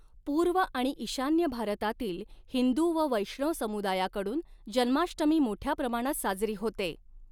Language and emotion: Marathi, neutral